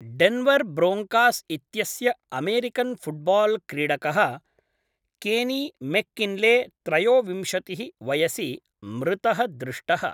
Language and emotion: Sanskrit, neutral